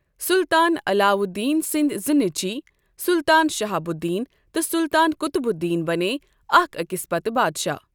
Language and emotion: Kashmiri, neutral